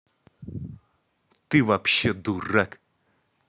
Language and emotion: Russian, angry